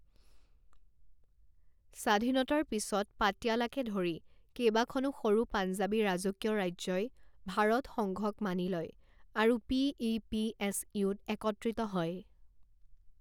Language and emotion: Assamese, neutral